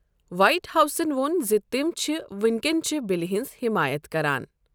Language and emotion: Kashmiri, neutral